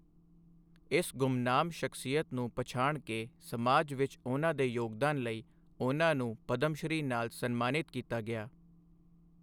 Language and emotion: Punjabi, neutral